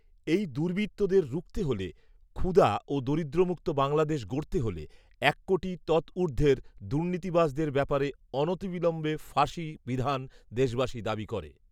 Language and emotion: Bengali, neutral